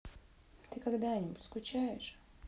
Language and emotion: Russian, sad